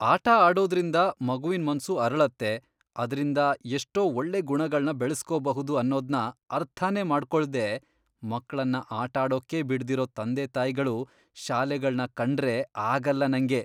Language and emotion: Kannada, disgusted